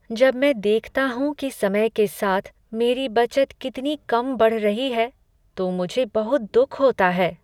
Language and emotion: Hindi, sad